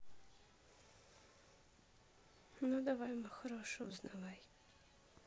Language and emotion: Russian, sad